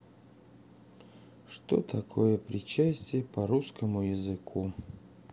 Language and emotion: Russian, sad